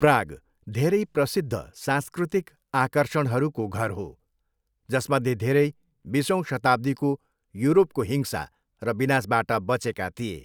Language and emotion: Nepali, neutral